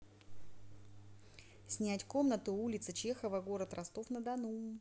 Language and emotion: Russian, neutral